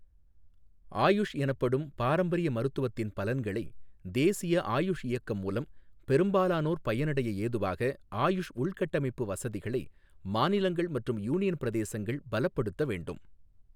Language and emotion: Tamil, neutral